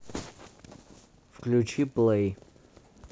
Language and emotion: Russian, neutral